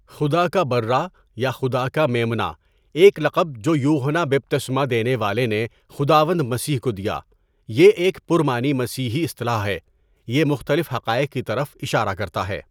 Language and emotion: Urdu, neutral